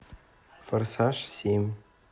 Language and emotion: Russian, neutral